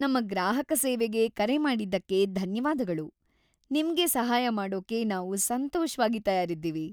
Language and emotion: Kannada, happy